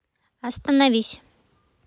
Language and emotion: Russian, neutral